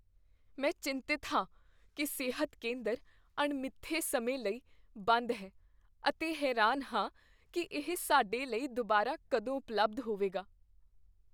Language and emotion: Punjabi, fearful